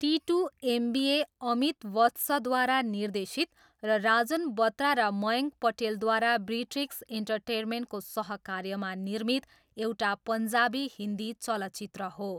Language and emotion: Nepali, neutral